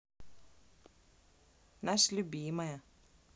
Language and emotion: Russian, positive